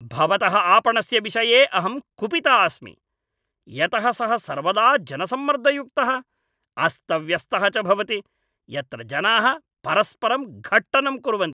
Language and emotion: Sanskrit, angry